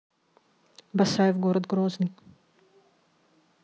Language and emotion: Russian, neutral